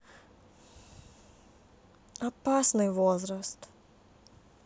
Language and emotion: Russian, sad